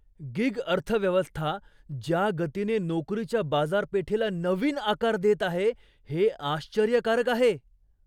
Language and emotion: Marathi, surprised